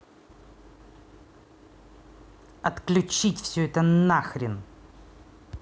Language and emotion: Russian, angry